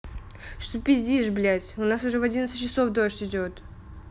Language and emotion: Russian, angry